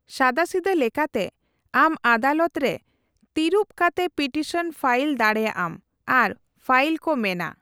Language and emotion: Santali, neutral